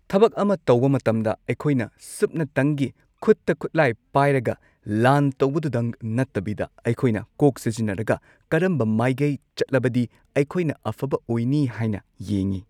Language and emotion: Manipuri, neutral